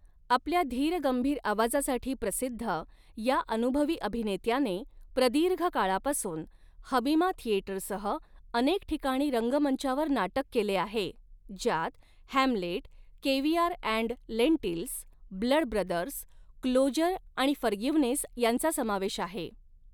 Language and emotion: Marathi, neutral